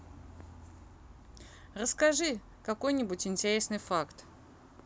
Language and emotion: Russian, neutral